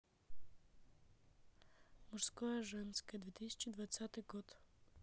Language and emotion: Russian, neutral